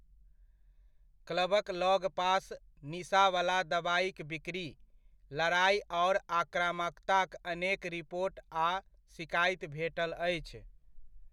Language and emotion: Maithili, neutral